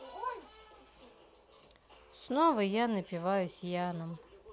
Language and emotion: Russian, sad